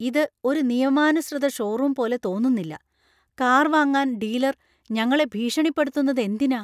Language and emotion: Malayalam, fearful